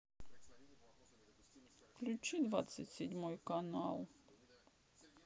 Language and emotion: Russian, sad